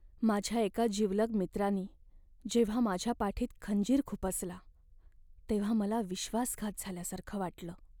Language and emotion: Marathi, sad